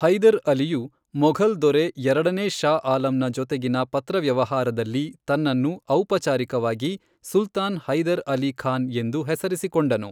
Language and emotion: Kannada, neutral